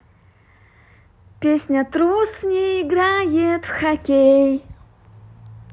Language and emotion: Russian, positive